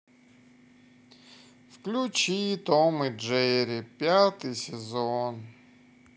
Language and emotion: Russian, sad